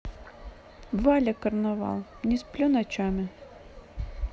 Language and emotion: Russian, neutral